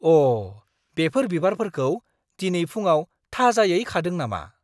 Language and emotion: Bodo, surprised